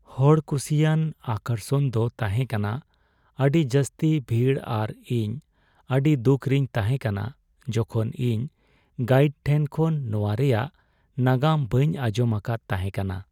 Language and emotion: Santali, sad